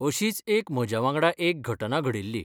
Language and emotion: Goan Konkani, neutral